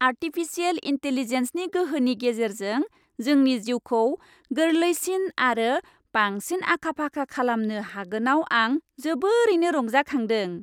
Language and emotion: Bodo, happy